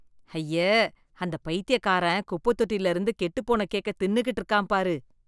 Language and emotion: Tamil, disgusted